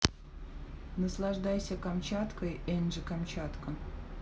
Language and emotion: Russian, neutral